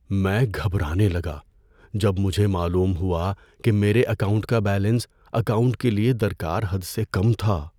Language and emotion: Urdu, fearful